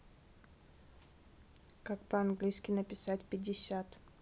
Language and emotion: Russian, neutral